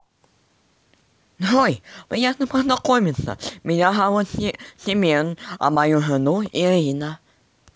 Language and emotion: Russian, positive